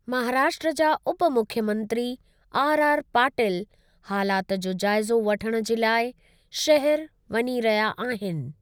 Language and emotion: Sindhi, neutral